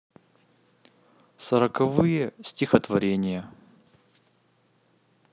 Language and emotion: Russian, neutral